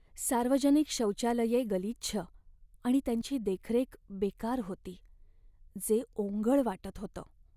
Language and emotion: Marathi, sad